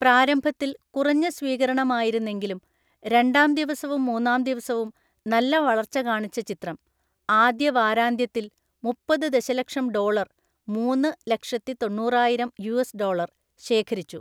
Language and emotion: Malayalam, neutral